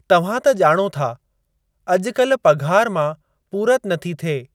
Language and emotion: Sindhi, neutral